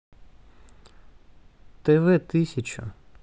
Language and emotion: Russian, neutral